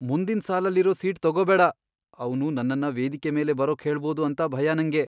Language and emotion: Kannada, fearful